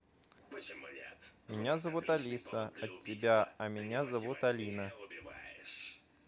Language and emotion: Russian, neutral